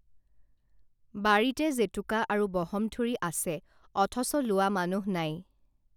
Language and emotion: Assamese, neutral